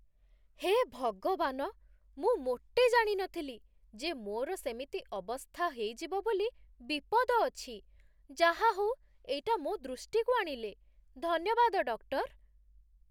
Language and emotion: Odia, surprised